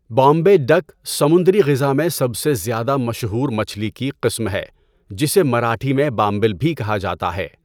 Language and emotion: Urdu, neutral